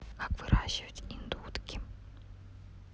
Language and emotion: Russian, neutral